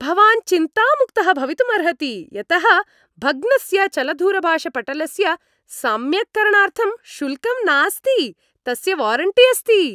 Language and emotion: Sanskrit, happy